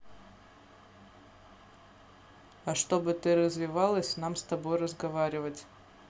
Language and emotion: Russian, neutral